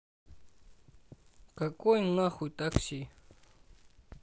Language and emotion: Russian, angry